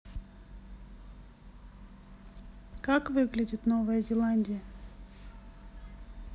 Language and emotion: Russian, neutral